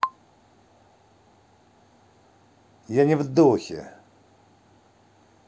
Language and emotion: Russian, angry